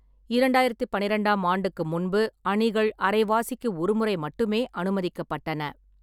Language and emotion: Tamil, neutral